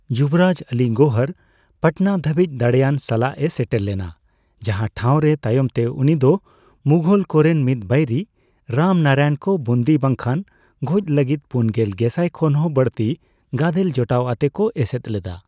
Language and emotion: Santali, neutral